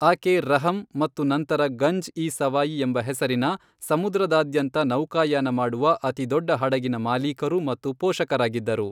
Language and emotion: Kannada, neutral